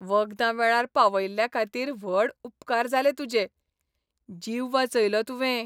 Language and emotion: Goan Konkani, happy